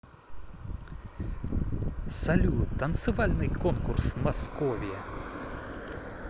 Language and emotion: Russian, positive